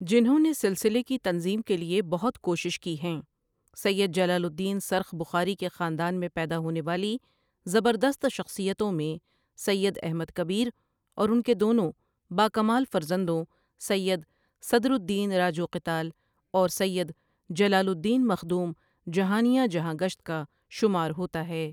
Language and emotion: Urdu, neutral